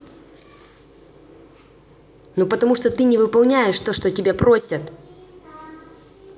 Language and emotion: Russian, angry